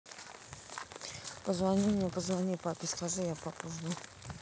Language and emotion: Russian, neutral